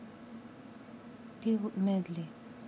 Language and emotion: Russian, neutral